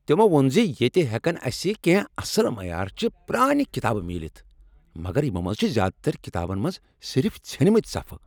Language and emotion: Kashmiri, angry